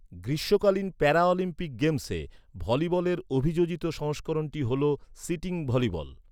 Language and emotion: Bengali, neutral